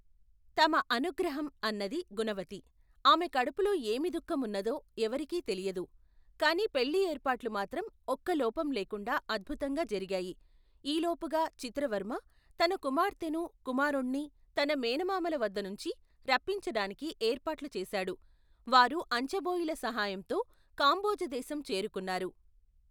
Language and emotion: Telugu, neutral